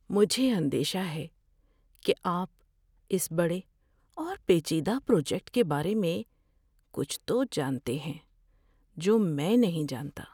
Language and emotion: Urdu, fearful